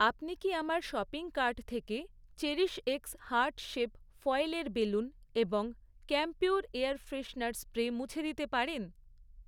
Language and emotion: Bengali, neutral